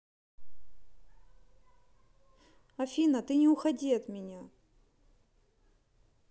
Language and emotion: Russian, neutral